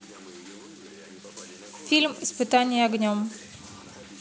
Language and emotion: Russian, neutral